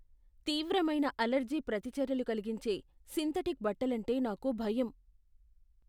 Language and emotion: Telugu, fearful